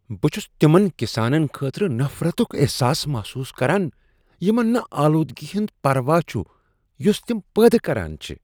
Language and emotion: Kashmiri, disgusted